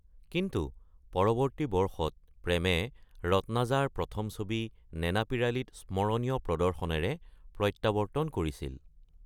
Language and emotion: Assamese, neutral